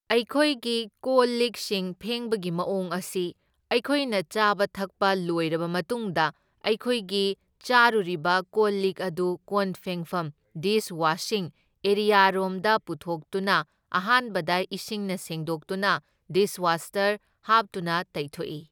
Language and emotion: Manipuri, neutral